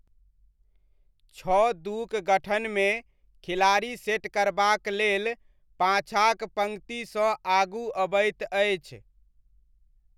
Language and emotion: Maithili, neutral